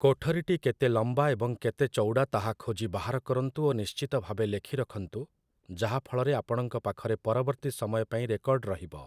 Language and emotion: Odia, neutral